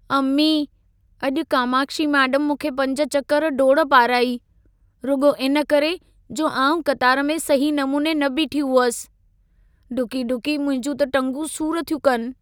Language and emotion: Sindhi, sad